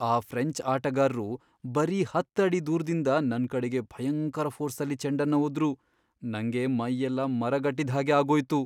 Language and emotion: Kannada, fearful